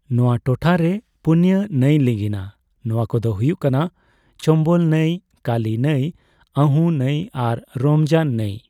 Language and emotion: Santali, neutral